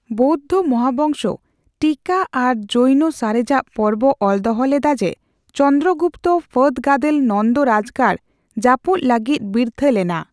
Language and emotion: Santali, neutral